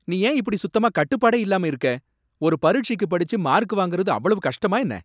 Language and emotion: Tamil, angry